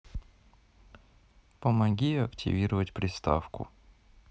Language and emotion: Russian, neutral